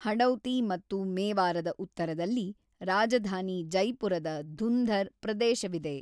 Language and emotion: Kannada, neutral